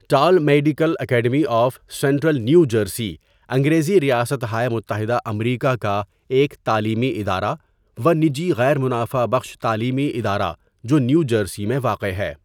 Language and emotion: Urdu, neutral